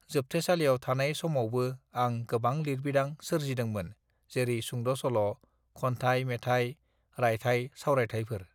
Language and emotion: Bodo, neutral